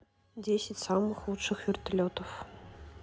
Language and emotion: Russian, neutral